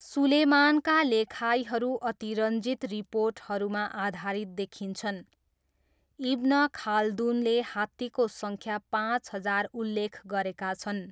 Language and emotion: Nepali, neutral